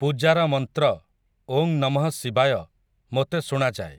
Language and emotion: Odia, neutral